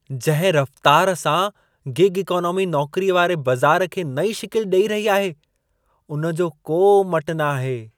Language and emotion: Sindhi, surprised